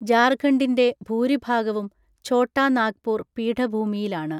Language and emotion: Malayalam, neutral